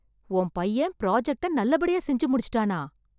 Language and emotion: Tamil, surprised